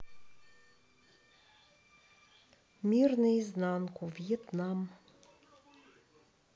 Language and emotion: Russian, neutral